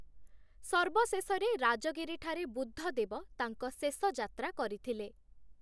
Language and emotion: Odia, neutral